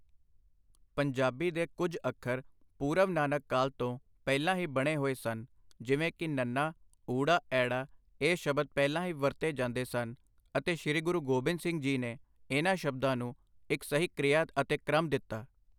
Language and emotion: Punjabi, neutral